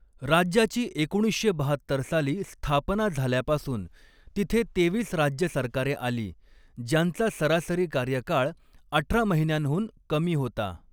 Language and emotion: Marathi, neutral